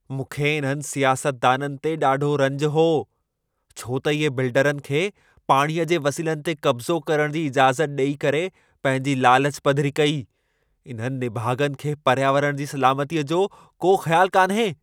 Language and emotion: Sindhi, angry